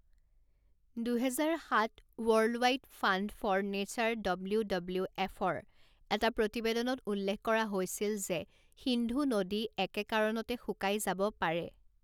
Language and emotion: Assamese, neutral